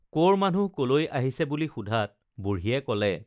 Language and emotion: Assamese, neutral